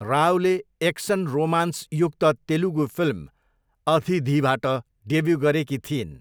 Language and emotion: Nepali, neutral